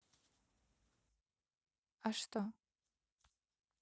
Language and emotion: Russian, neutral